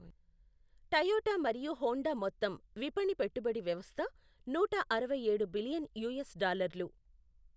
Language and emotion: Telugu, neutral